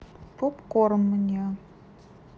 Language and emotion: Russian, neutral